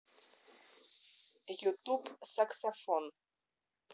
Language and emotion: Russian, neutral